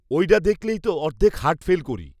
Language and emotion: Bengali, neutral